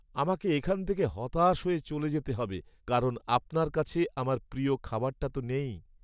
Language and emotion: Bengali, sad